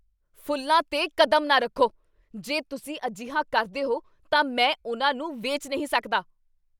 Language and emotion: Punjabi, angry